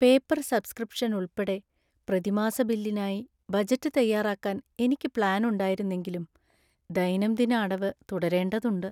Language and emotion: Malayalam, sad